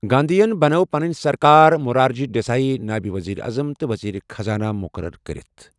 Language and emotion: Kashmiri, neutral